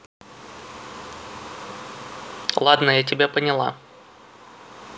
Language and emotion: Russian, neutral